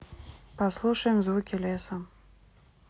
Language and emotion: Russian, neutral